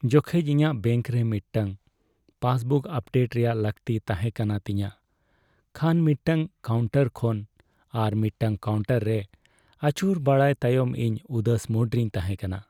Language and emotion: Santali, sad